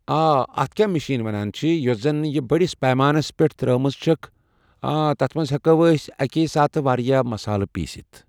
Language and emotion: Kashmiri, neutral